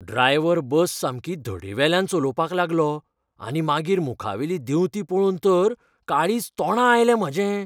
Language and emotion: Goan Konkani, fearful